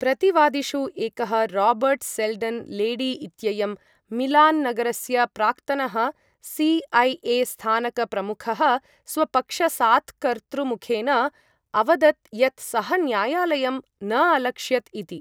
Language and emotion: Sanskrit, neutral